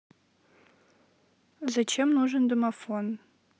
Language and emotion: Russian, neutral